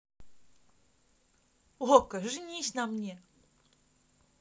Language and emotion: Russian, positive